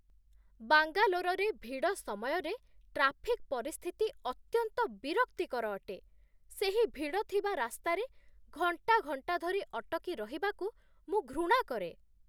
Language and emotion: Odia, disgusted